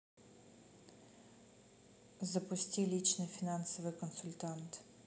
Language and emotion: Russian, neutral